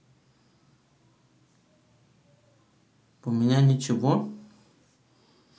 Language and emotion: Russian, neutral